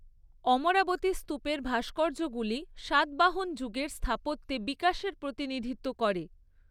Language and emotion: Bengali, neutral